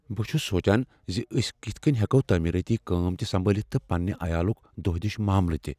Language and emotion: Kashmiri, fearful